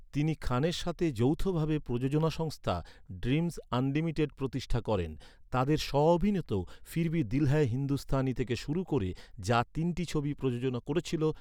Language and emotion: Bengali, neutral